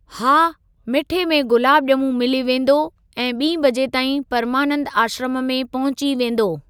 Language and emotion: Sindhi, neutral